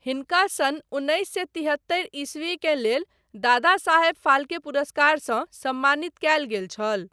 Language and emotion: Maithili, neutral